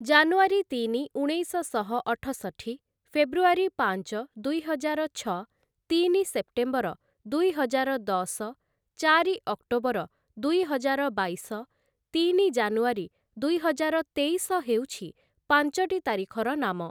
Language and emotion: Odia, neutral